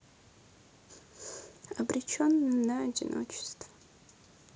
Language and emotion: Russian, sad